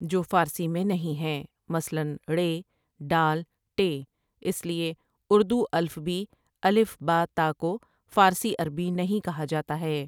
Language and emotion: Urdu, neutral